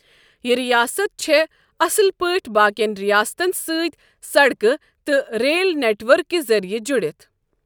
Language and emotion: Kashmiri, neutral